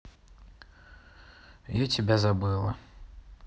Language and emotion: Russian, sad